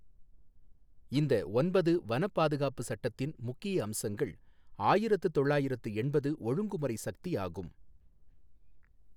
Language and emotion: Tamil, neutral